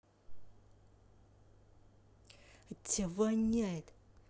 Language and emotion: Russian, angry